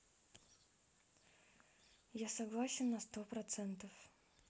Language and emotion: Russian, neutral